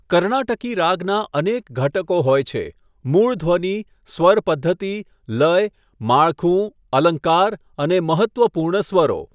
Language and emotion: Gujarati, neutral